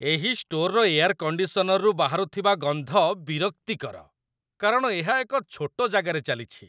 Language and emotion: Odia, disgusted